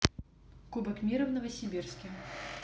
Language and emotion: Russian, neutral